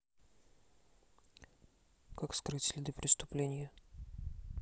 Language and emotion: Russian, neutral